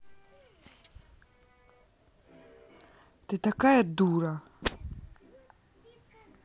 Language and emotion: Russian, angry